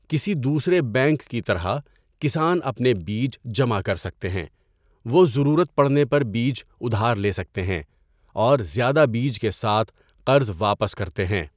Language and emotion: Urdu, neutral